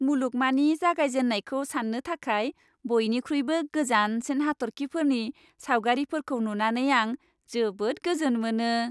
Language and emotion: Bodo, happy